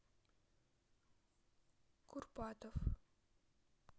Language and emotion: Russian, neutral